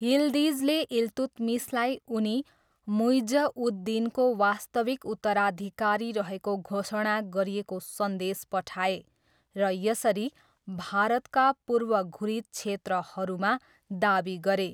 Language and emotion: Nepali, neutral